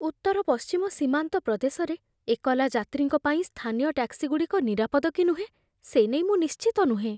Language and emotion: Odia, fearful